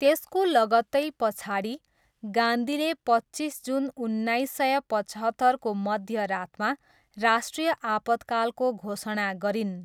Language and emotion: Nepali, neutral